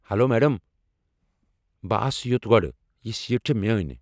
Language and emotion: Kashmiri, angry